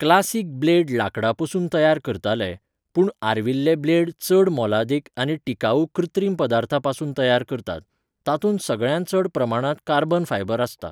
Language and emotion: Goan Konkani, neutral